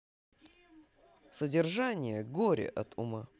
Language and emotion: Russian, positive